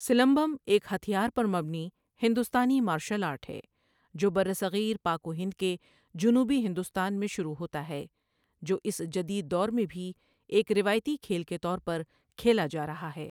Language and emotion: Urdu, neutral